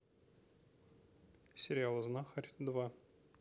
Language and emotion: Russian, neutral